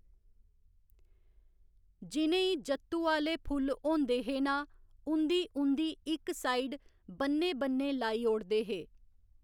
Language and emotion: Dogri, neutral